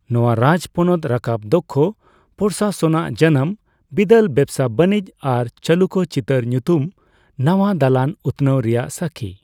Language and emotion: Santali, neutral